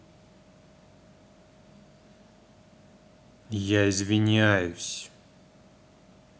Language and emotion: Russian, angry